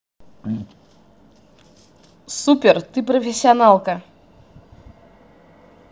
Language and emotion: Russian, positive